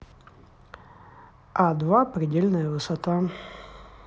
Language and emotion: Russian, neutral